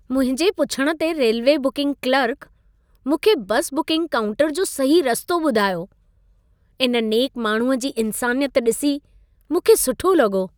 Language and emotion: Sindhi, happy